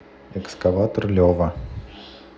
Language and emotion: Russian, neutral